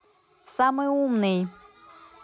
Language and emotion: Russian, neutral